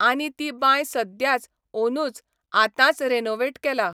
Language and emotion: Goan Konkani, neutral